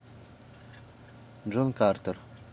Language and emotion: Russian, neutral